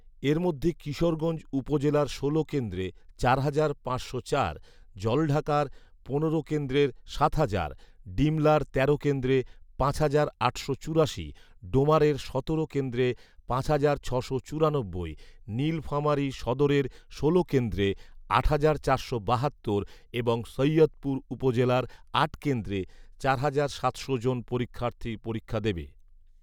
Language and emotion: Bengali, neutral